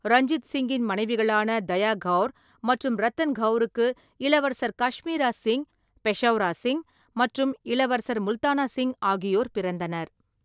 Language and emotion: Tamil, neutral